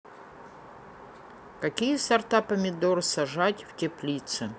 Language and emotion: Russian, neutral